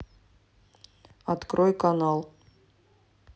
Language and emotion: Russian, neutral